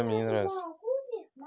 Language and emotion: Russian, neutral